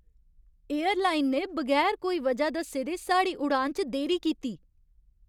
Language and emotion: Dogri, angry